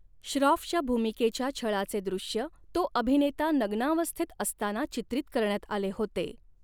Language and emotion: Marathi, neutral